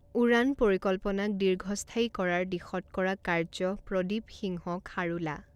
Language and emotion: Assamese, neutral